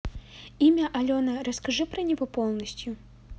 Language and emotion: Russian, neutral